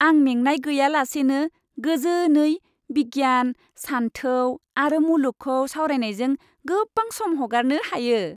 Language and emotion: Bodo, happy